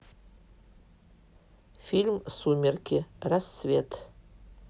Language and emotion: Russian, neutral